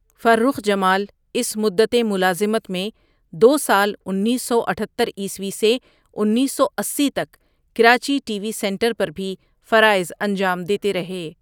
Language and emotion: Urdu, neutral